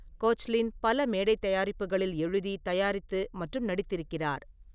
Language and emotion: Tamil, neutral